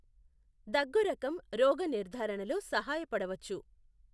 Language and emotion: Telugu, neutral